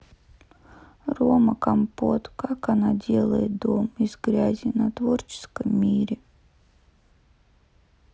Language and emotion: Russian, sad